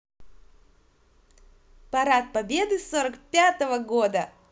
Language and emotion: Russian, positive